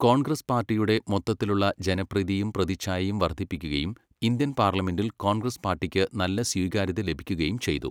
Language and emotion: Malayalam, neutral